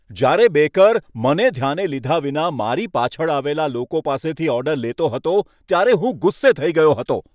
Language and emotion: Gujarati, angry